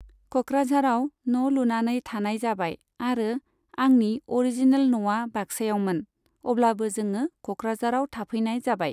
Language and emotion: Bodo, neutral